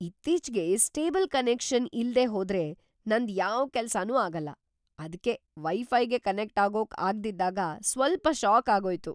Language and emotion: Kannada, surprised